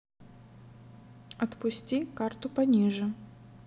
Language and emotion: Russian, neutral